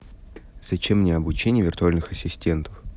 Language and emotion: Russian, neutral